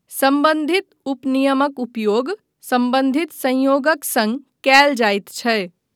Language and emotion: Maithili, neutral